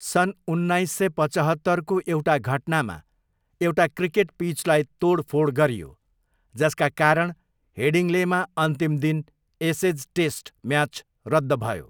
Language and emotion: Nepali, neutral